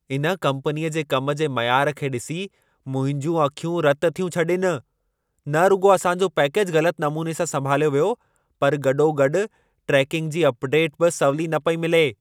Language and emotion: Sindhi, angry